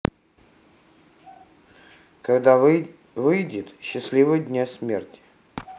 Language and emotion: Russian, neutral